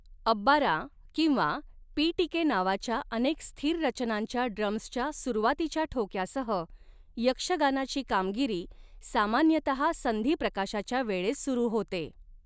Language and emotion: Marathi, neutral